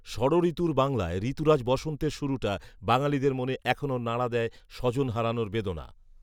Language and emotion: Bengali, neutral